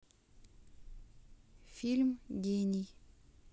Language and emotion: Russian, neutral